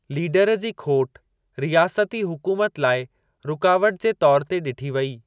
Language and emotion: Sindhi, neutral